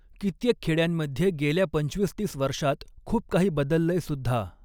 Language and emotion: Marathi, neutral